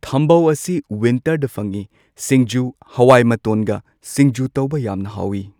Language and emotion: Manipuri, neutral